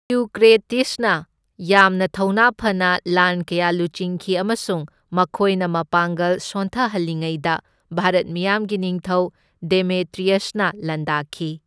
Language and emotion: Manipuri, neutral